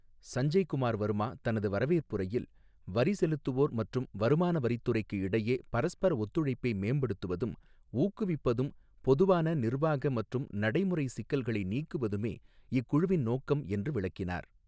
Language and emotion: Tamil, neutral